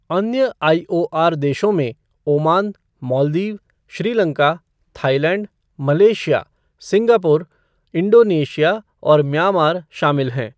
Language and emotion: Hindi, neutral